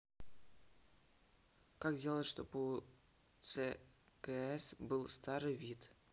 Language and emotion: Russian, neutral